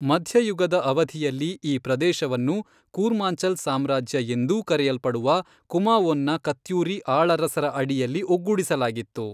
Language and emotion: Kannada, neutral